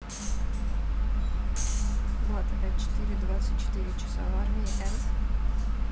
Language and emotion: Russian, neutral